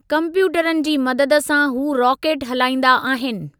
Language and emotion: Sindhi, neutral